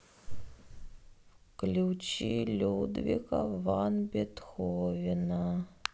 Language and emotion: Russian, sad